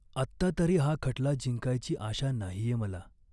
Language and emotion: Marathi, sad